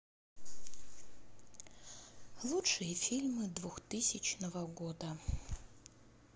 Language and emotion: Russian, sad